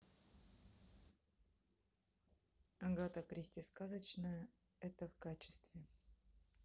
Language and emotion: Russian, neutral